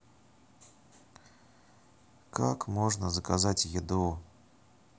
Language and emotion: Russian, neutral